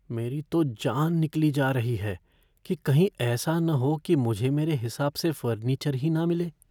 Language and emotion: Hindi, fearful